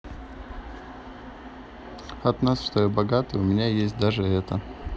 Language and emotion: Russian, sad